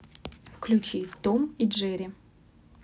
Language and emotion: Russian, neutral